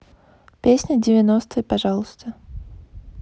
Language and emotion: Russian, neutral